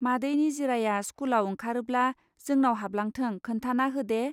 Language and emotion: Bodo, neutral